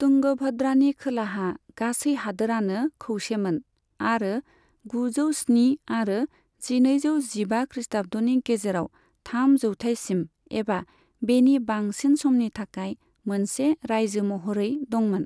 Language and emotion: Bodo, neutral